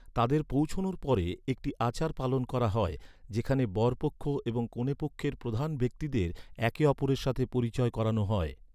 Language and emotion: Bengali, neutral